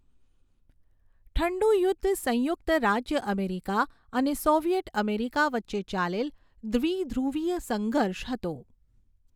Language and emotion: Gujarati, neutral